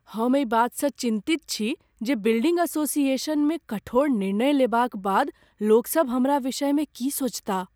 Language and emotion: Maithili, fearful